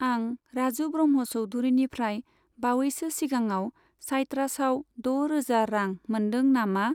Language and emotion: Bodo, neutral